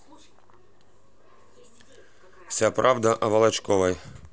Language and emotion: Russian, neutral